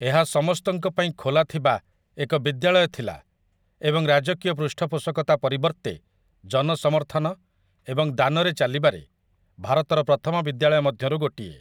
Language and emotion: Odia, neutral